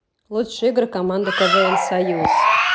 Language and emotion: Russian, neutral